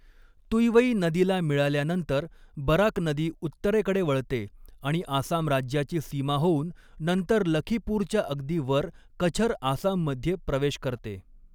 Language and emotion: Marathi, neutral